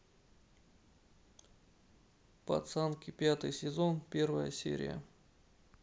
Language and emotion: Russian, neutral